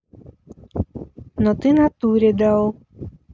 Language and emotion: Russian, neutral